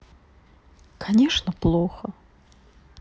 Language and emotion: Russian, sad